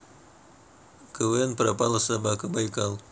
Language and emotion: Russian, neutral